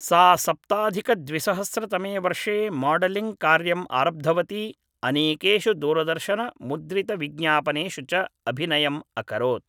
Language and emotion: Sanskrit, neutral